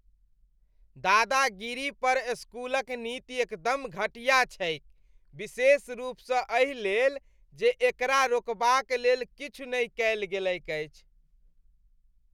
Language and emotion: Maithili, disgusted